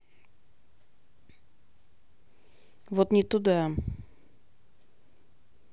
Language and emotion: Russian, neutral